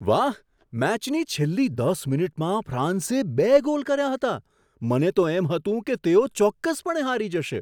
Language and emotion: Gujarati, surprised